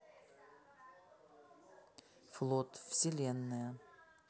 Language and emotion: Russian, neutral